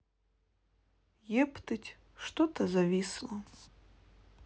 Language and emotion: Russian, sad